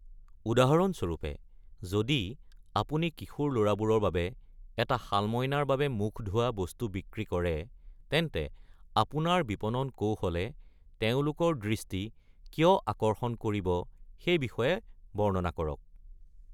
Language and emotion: Assamese, neutral